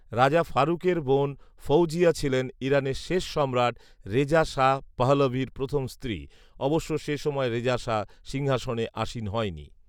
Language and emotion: Bengali, neutral